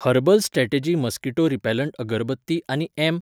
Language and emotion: Goan Konkani, neutral